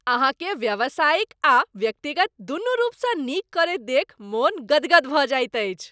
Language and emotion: Maithili, happy